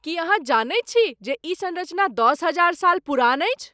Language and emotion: Maithili, surprised